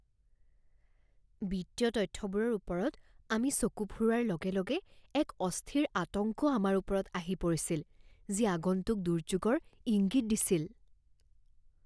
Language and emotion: Assamese, fearful